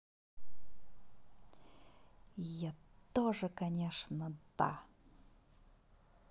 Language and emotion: Russian, angry